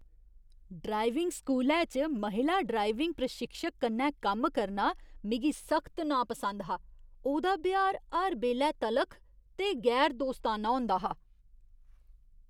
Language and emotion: Dogri, disgusted